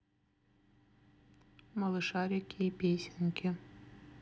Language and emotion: Russian, neutral